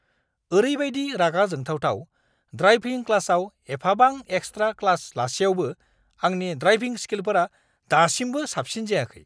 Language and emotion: Bodo, angry